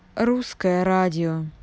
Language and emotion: Russian, neutral